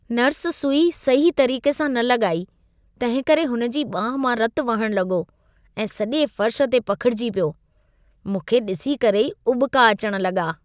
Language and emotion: Sindhi, disgusted